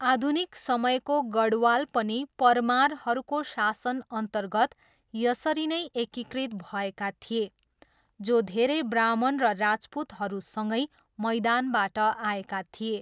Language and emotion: Nepali, neutral